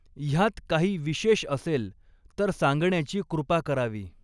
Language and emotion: Marathi, neutral